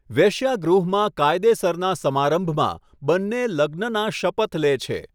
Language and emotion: Gujarati, neutral